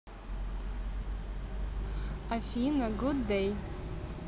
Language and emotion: Russian, positive